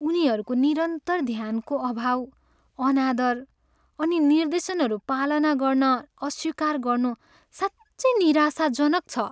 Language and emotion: Nepali, sad